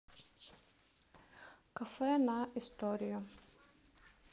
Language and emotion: Russian, neutral